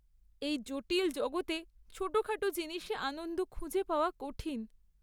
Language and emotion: Bengali, sad